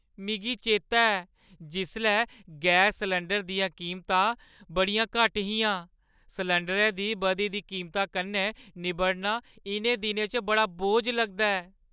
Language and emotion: Dogri, sad